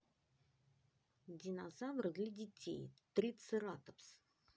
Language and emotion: Russian, neutral